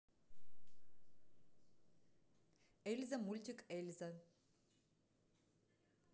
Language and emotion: Russian, neutral